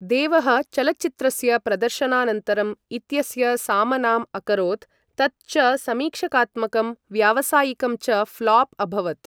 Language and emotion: Sanskrit, neutral